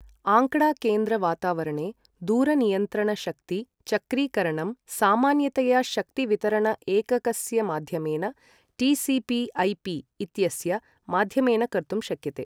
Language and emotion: Sanskrit, neutral